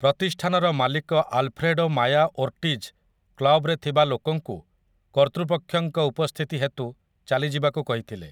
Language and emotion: Odia, neutral